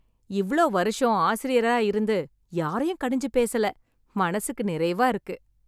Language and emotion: Tamil, happy